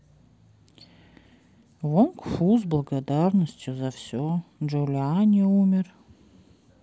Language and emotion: Russian, neutral